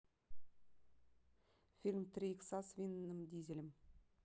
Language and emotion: Russian, neutral